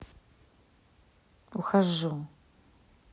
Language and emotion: Russian, angry